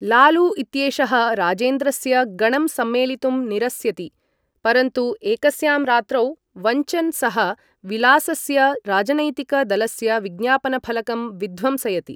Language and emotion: Sanskrit, neutral